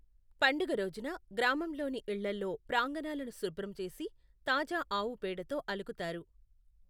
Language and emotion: Telugu, neutral